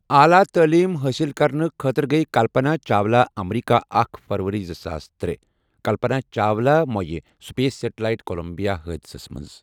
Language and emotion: Kashmiri, neutral